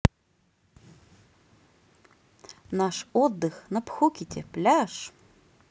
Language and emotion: Russian, positive